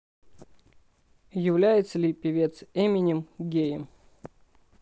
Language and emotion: Russian, neutral